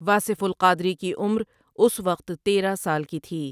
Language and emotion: Urdu, neutral